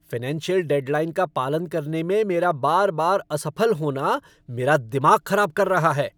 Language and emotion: Hindi, angry